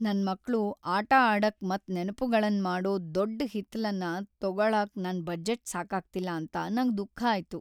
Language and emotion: Kannada, sad